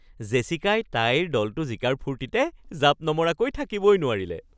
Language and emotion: Assamese, happy